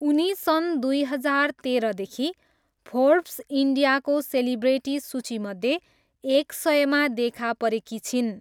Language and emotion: Nepali, neutral